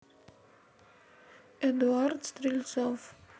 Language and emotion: Russian, neutral